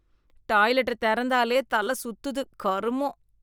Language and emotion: Tamil, disgusted